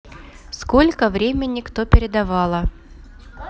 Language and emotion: Russian, neutral